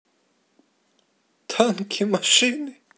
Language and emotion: Russian, positive